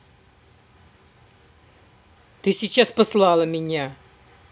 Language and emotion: Russian, angry